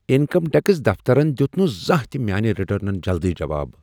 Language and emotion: Kashmiri, surprised